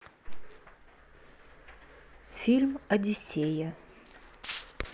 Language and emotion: Russian, neutral